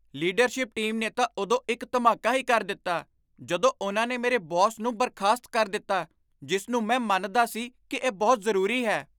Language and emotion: Punjabi, surprised